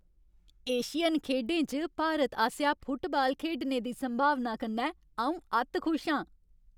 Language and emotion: Dogri, happy